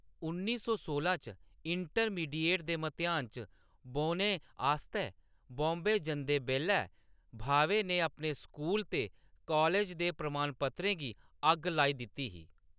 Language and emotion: Dogri, neutral